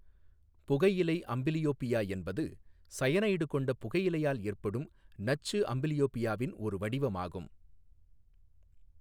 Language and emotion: Tamil, neutral